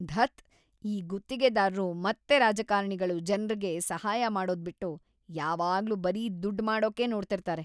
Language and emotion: Kannada, disgusted